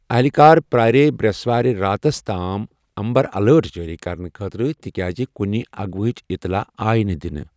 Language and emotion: Kashmiri, neutral